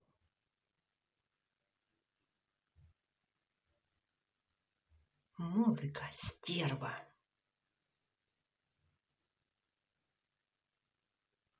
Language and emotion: Russian, angry